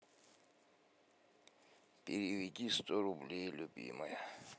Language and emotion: Russian, sad